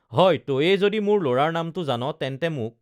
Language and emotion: Assamese, neutral